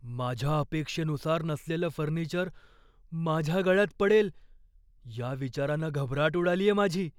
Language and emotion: Marathi, fearful